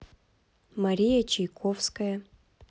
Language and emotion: Russian, neutral